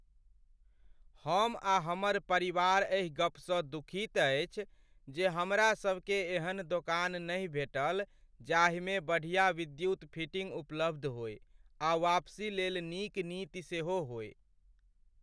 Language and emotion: Maithili, sad